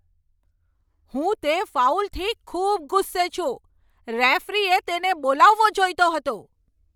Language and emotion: Gujarati, angry